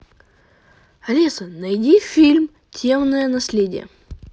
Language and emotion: Russian, positive